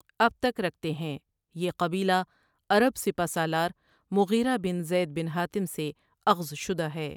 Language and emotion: Urdu, neutral